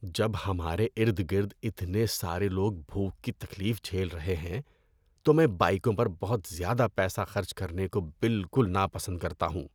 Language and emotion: Urdu, disgusted